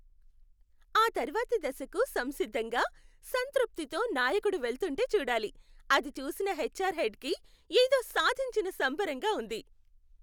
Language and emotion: Telugu, happy